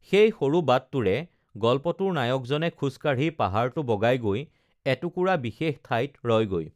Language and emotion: Assamese, neutral